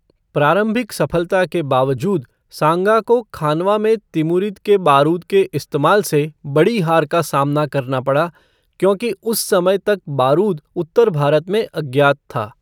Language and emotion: Hindi, neutral